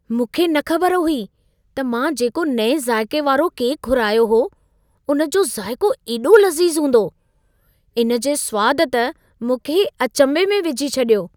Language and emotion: Sindhi, surprised